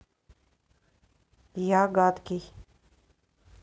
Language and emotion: Russian, neutral